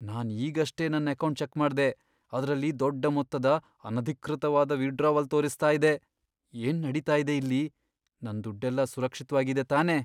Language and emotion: Kannada, fearful